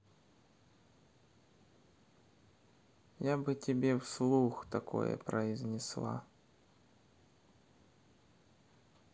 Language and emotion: Russian, neutral